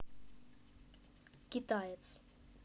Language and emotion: Russian, neutral